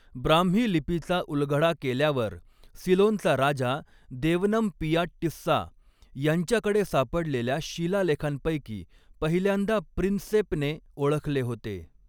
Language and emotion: Marathi, neutral